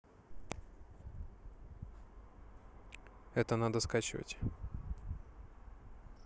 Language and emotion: Russian, neutral